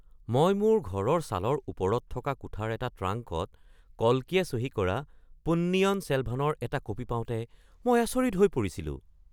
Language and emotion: Assamese, surprised